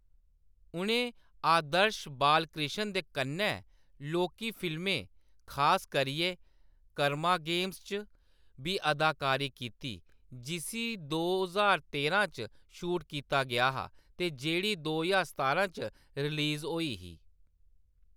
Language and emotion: Dogri, neutral